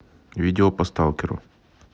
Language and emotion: Russian, neutral